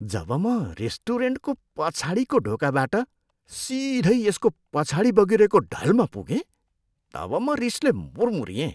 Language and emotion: Nepali, disgusted